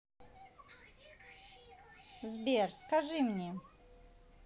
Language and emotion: Russian, neutral